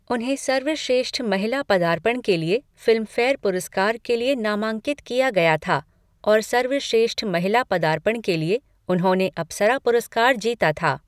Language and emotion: Hindi, neutral